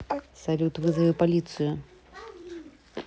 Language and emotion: Russian, neutral